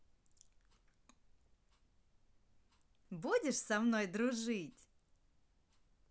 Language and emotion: Russian, positive